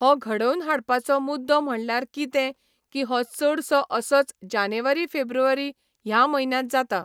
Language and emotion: Goan Konkani, neutral